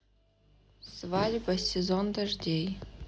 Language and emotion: Russian, sad